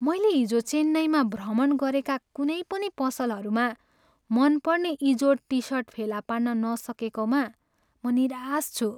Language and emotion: Nepali, sad